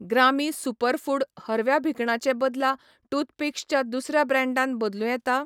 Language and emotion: Goan Konkani, neutral